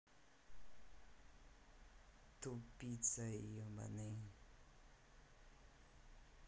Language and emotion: Russian, angry